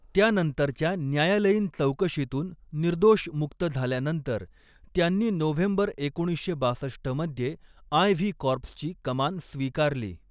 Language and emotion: Marathi, neutral